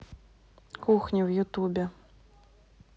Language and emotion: Russian, neutral